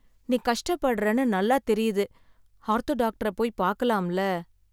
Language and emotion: Tamil, sad